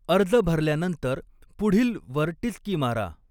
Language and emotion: Marathi, neutral